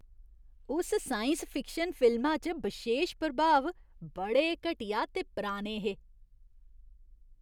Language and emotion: Dogri, disgusted